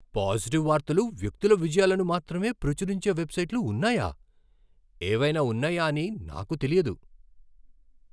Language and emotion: Telugu, surprised